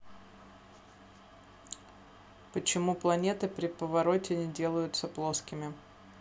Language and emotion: Russian, neutral